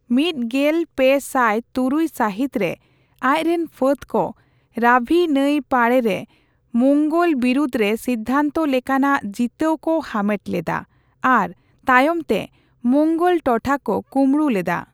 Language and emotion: Santali, neutral